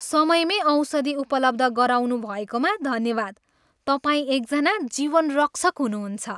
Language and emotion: Nepali, happy